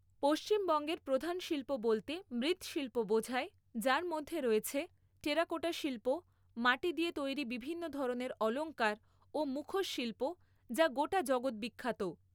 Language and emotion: Bengali, neutral